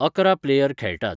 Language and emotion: Goan Konkani, neutral